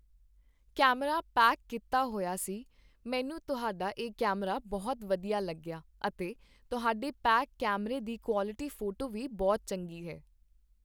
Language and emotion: Punjabi, neutral